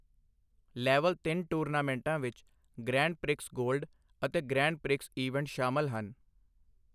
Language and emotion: Punjabi, neutral